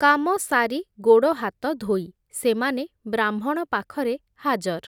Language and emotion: Odia, neutral